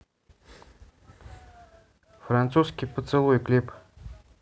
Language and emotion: Russian, neutral